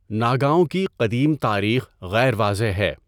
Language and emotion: Urdu, neutral